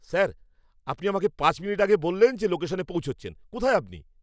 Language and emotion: Bengali, angry